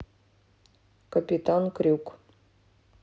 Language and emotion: Russian, neutral